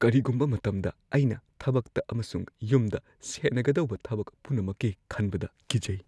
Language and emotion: Manipuri, fearful